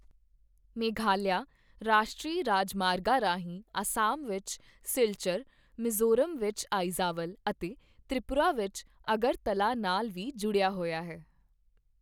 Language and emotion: Punjabi, neutral